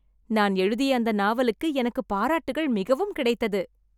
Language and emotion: Tamil, happy